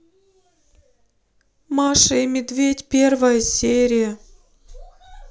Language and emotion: Russian, sad